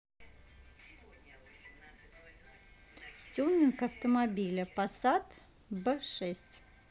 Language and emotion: Russian, neutral